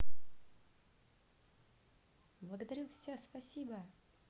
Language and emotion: Russian, neutral